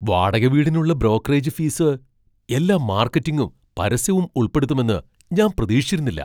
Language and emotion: Malayalam, surprised